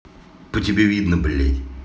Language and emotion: Russian, angry